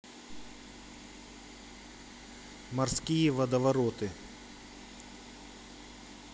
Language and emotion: Russian, neutral